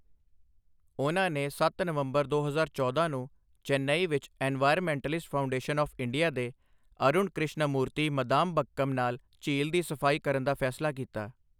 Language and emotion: Punjabi, neutral